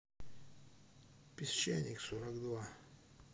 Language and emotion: Russian, neutral